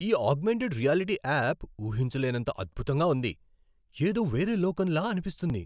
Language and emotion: Telugu, surprised